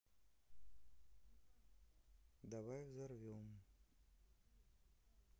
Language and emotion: Russian, neutral